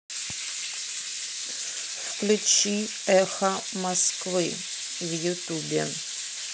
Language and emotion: Russian, neutral